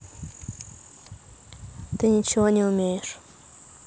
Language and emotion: Russian, neutral